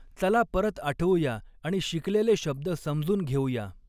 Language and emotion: Marathi, neutral